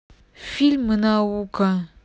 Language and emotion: Russian, neutral